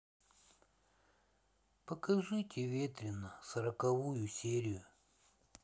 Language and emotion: Russian, sad